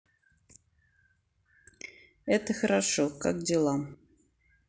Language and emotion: Russian, neutral